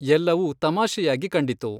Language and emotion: Kannada, neutral